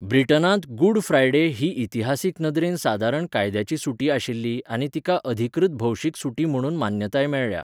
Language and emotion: Goan Konkani, neutral